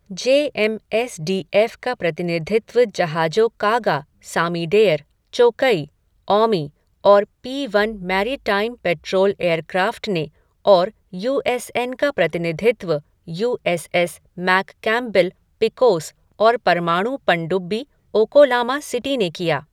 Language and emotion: Hindi, neutral